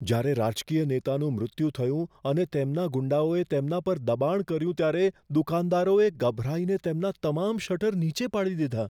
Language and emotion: Gujarati, fearful